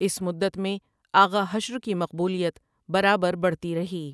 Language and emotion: Urdu, neutral